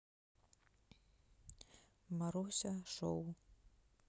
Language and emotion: Russian, neutral